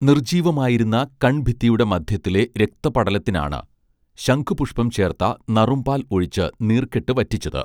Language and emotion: Malayalam, neutral